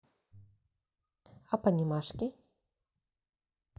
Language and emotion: Russian, neutral